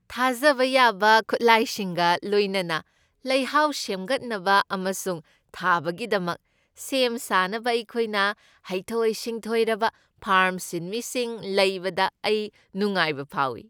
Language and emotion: Manipuri, happy